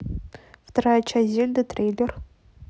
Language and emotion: Russian, neutral